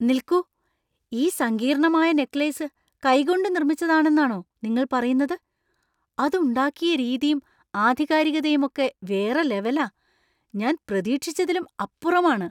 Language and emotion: Malayalam, surprised